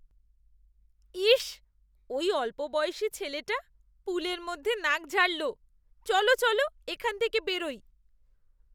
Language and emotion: Bengali, disgusted